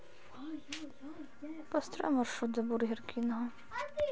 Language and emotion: Russian, sad